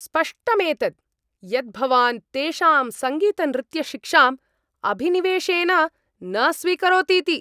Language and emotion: Sanskrit, angry